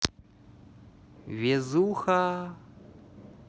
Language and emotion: Russian, positive